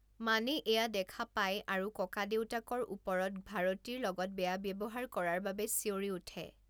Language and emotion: Assamese, neutral